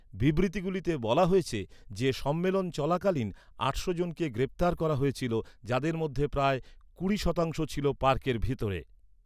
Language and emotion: Bengali, neutral